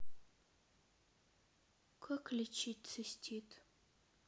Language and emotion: Russian, sad